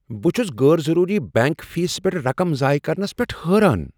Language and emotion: Kashmiri, surprised